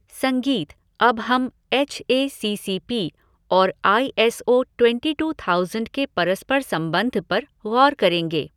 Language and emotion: Hindi, neutral